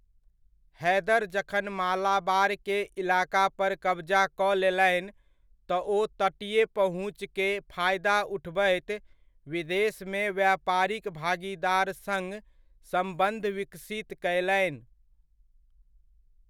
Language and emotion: Maithili, neutral